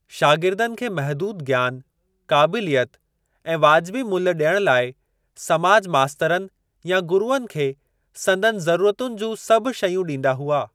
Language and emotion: Sindhi, neutral